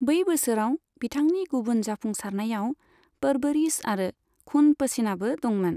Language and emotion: Bodo, neutral